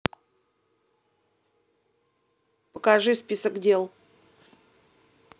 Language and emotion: Russian, angry